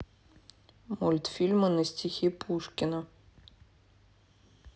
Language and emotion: Russian, neutral